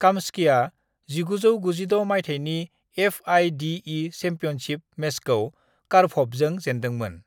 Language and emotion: Bodo, neutral